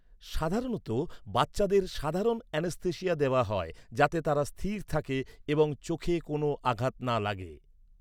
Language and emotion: Bengali, neutral